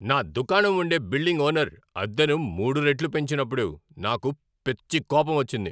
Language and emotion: Telugu, angry